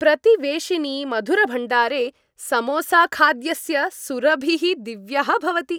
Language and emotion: Sanskrit, happy